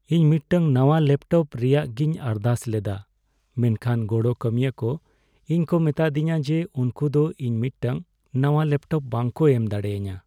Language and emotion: Santali, sad